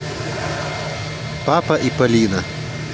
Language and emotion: Russian, neutral